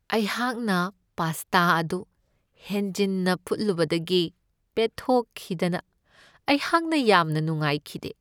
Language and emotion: Manipuri, sad